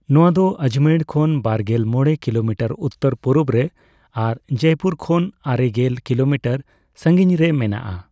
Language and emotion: Santali, neutral